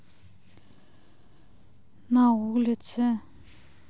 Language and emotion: Russian, sad